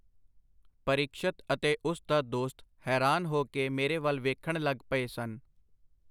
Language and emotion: Punjabi, neutral